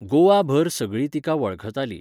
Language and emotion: Goan Konkani, neutral